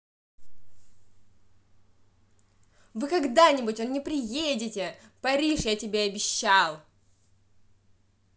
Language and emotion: Russian, angry